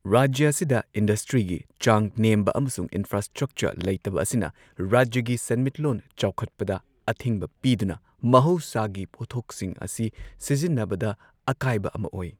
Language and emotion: Manipuri, neutral